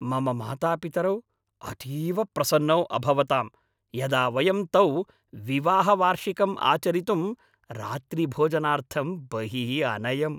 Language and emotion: Sanskrit, happy